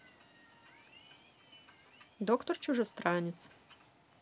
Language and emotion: Russian, positive